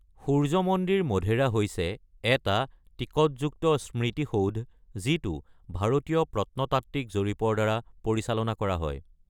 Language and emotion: Assamese, neutral